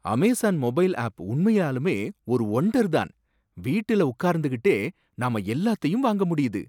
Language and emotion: Tamil, surprised